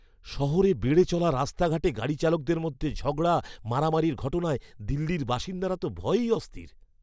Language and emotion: Bengali, fearful